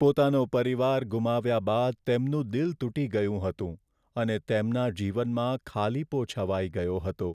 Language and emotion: Gujarati, sad